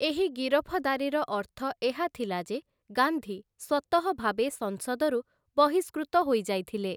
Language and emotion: Odia, neutral